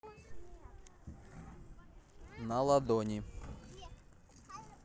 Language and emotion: Russian, neutral